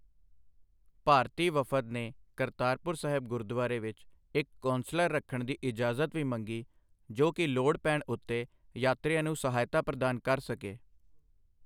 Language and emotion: Punjabi, neutral